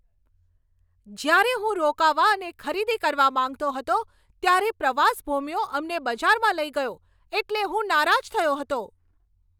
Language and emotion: Gujarati, angry